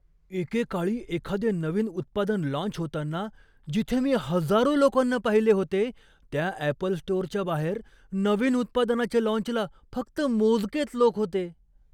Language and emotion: Marathi, surprised